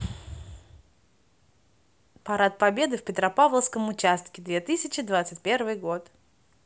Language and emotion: Russian, positive